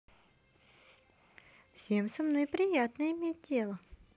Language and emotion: Russian, positive